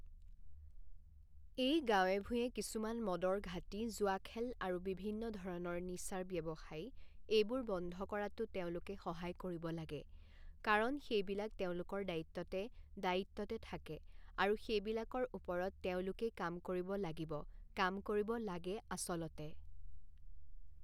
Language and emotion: Assamese, neutral